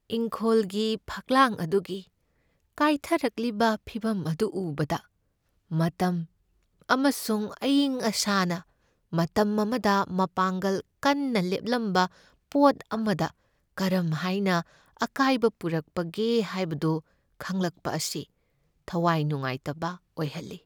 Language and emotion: Manipuri, sad